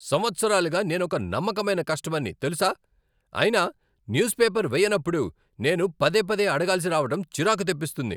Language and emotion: Telugu, angry